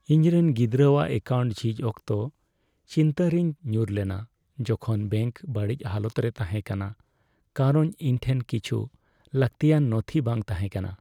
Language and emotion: Santali, sad